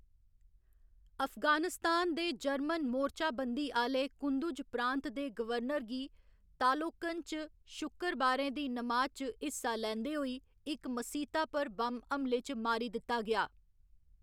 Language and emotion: Dogri, neutral